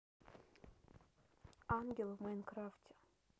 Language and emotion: Russian, neutral